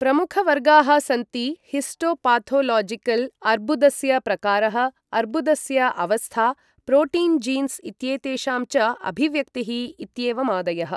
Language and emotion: Sanskrit, neutral